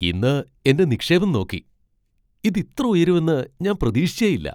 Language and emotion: Malayalam, surprised